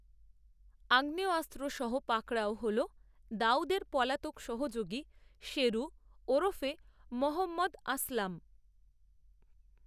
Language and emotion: Bengali, neutral